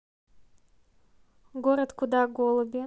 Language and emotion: Russian, neutral